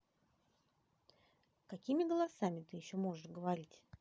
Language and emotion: Russian, positive